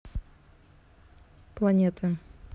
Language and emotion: Russian, neutral